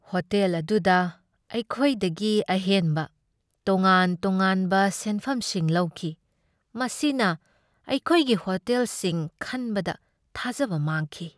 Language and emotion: Manipuri, sad